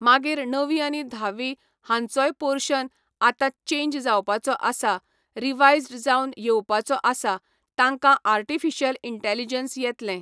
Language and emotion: Goan Konkani, neutral